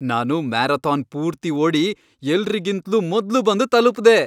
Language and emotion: Kannada, happy